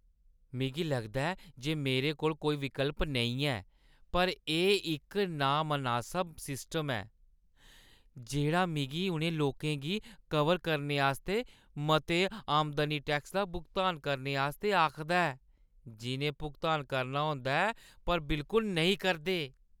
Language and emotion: Dogri, disgusted